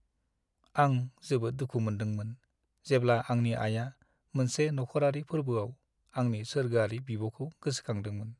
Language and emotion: Bodo, sad